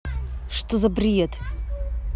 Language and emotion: Russian, angry